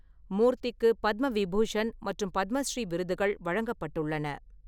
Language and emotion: Tamil, neutral